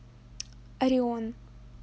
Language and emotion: Russian, neutral